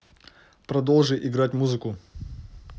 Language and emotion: Russian, neutral